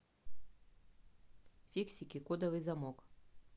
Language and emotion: Russian, neutral